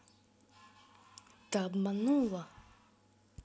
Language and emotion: Russian, angry